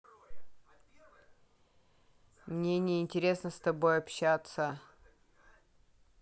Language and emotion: Russian, neutral